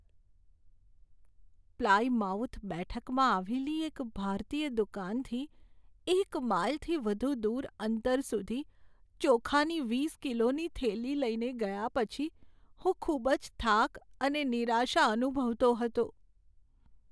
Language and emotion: Gujarati, sad